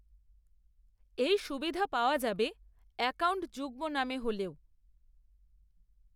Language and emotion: Bengali, neutral